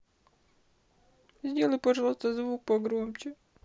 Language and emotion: Russian, sad